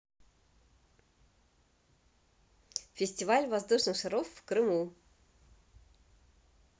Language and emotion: Russian, positive